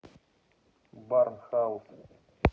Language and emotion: Russian, neutral